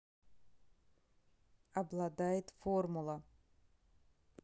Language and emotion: Russian, neutral